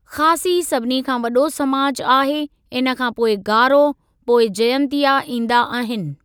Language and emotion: Sindhi, neutral